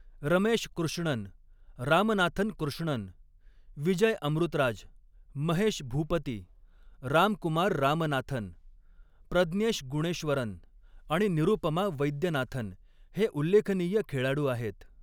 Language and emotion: Marathi, neutral